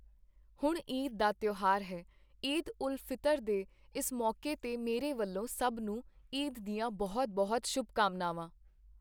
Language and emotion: Punjabi, neutral